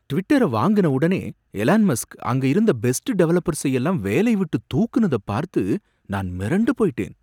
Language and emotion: Tamil, surprised